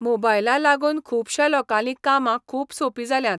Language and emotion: Goan Konkani, neutral